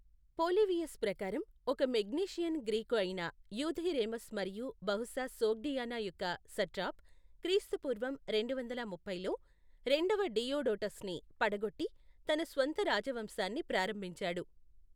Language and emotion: Telugu, neutral